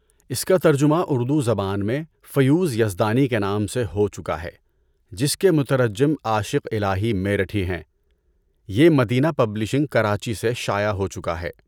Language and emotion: Urdu, neutral